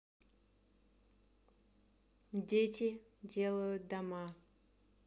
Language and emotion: Russian, neutral